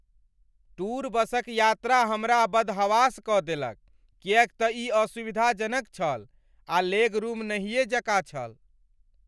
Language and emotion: Maithili, angry